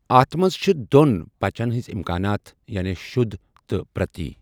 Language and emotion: Kashmiri, neutral